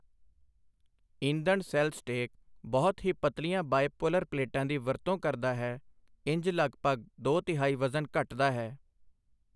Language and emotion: Punjabi, neutral